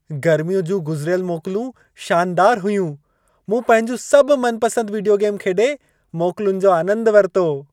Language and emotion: Sindhi, happy